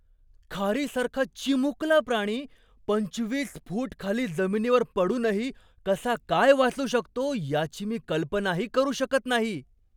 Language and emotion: Marathi, surprised